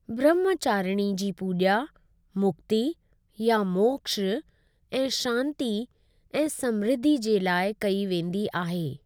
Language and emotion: Sindhi, neutral